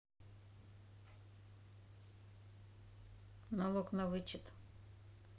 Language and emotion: Russian, neutral